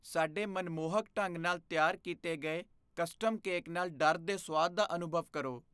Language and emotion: Punjabi, fearful